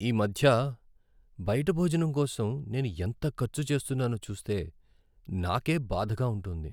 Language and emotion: Telugu, sad